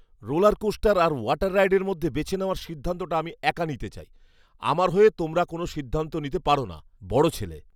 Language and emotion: Bengali, angry